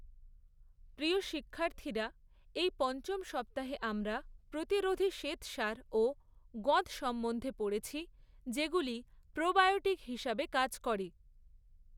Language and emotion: Bengali, neutral